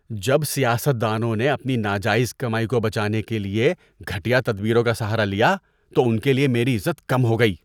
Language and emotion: Urdu, disgusted